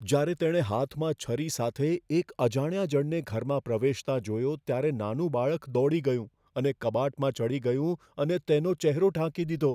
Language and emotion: Gujarati, fearful